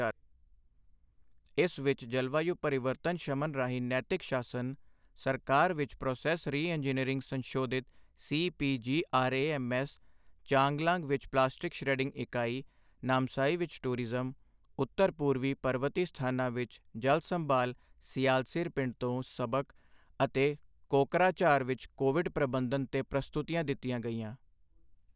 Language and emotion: Punjabi, neutral